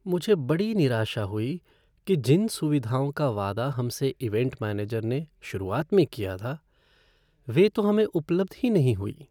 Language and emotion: Hindi, sad